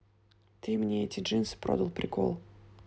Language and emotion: Russian, neutral